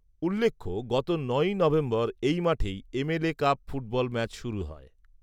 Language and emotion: Bengali, neutral